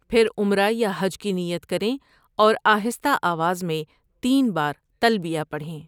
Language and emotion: Urdu, neutral